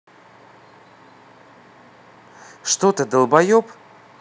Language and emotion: Russian, angry